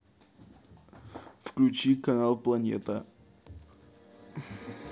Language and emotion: Russian, neutral